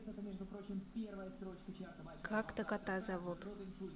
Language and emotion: Russian, neutral